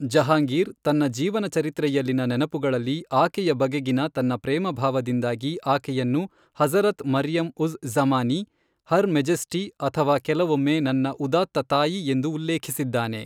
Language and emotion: Kannada, neutral